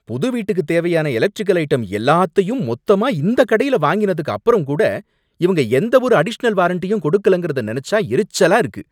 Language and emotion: Tamil, angry